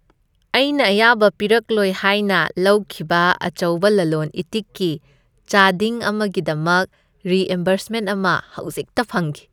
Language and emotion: Manipuri, happy